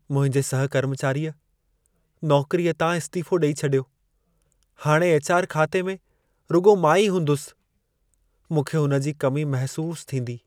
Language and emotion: Sindhi, sad